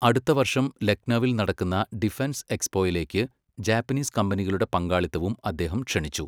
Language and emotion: Malayalam, neutral